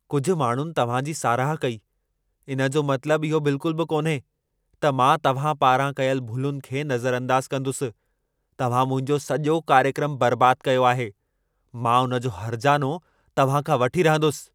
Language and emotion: Sindhi, angry